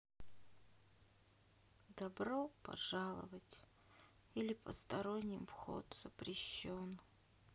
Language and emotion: Russian, sad